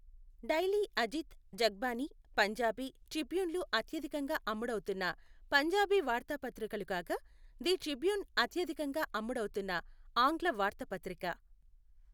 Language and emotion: Telugu, neutral